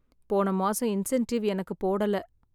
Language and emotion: Tamil, sad